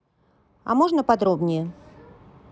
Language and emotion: Russian, neutral